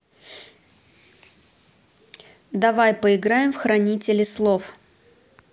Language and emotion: Russian, neutral